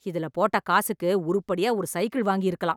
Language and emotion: Tamil, angry